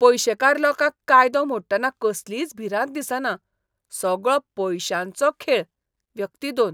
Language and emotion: Goan Konkani, disgusted